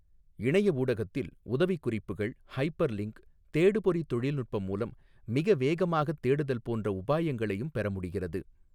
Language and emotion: Tamil, neutral